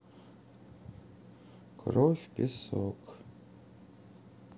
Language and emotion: Russian, sad